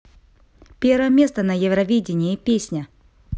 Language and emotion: Russian, neutral